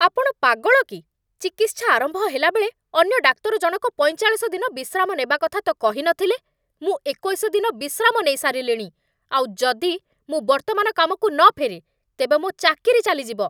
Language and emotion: Odia, angry